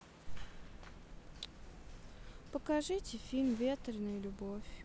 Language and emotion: Russian, sad